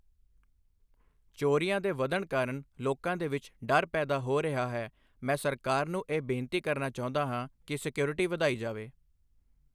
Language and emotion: Punjabi, neutral